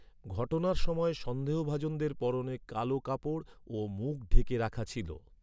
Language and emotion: Bengali, neutral